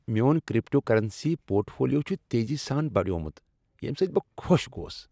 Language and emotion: Kashmiri, happy